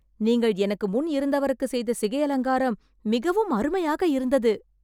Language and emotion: Tamil, surprised